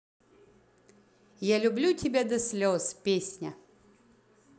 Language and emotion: Russian, positive